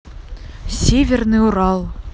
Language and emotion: Russian, neutral